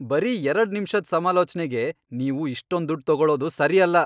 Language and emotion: Kannada, angry